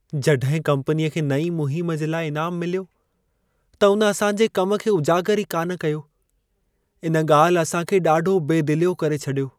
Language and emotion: Sindhi, sad